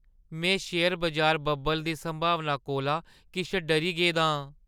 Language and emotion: Dogri, fearful